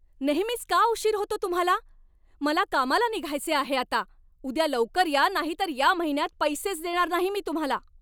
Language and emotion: Marathi, angry